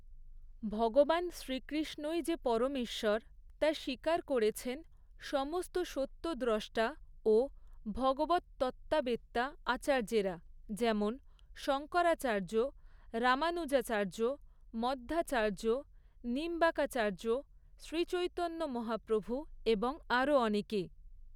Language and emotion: Bengali, neutral